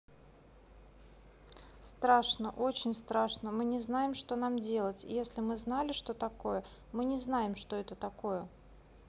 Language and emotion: Russian, neutral